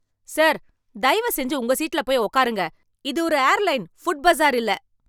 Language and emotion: Tamil, angry